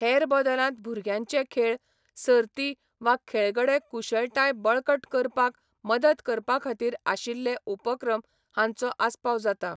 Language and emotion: Goan Konkani, neutral